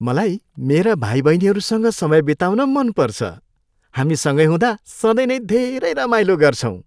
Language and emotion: Nepali, happy